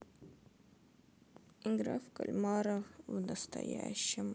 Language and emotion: Russian, sad